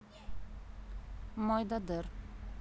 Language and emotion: Russian, neutral